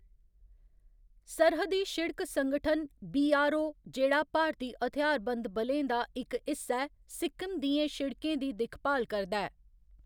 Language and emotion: Dogri, neutral